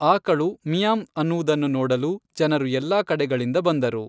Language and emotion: Kannada, neutral